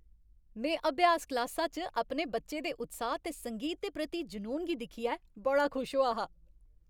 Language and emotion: Dogri, happy